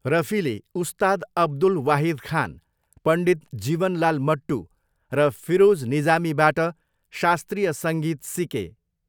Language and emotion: Nepali, neutral